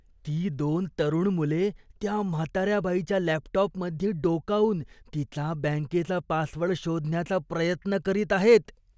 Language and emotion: Marathi, disgusted